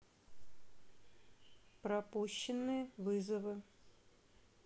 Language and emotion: Russian, neutral